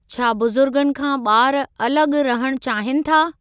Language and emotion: Sindhi, neutral